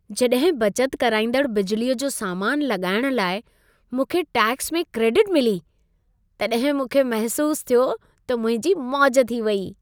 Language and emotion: Sindhi, happy